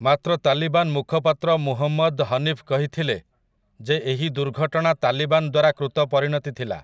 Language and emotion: Odia, neutral